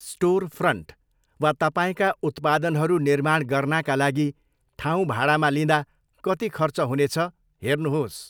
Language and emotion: Nepali, neutral